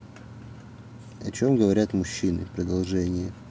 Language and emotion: Russian, neutral